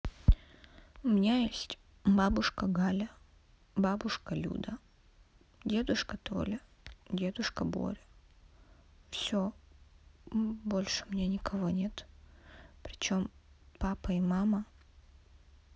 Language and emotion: Russian, sad